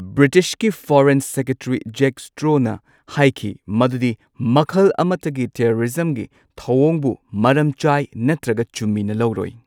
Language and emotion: Manipuri, neutral